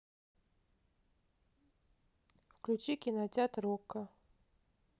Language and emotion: Russian, neutral